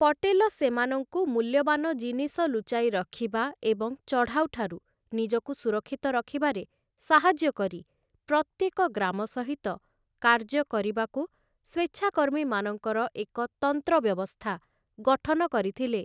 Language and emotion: Odia, neutral